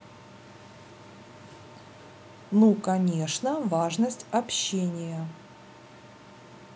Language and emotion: Russian, neutral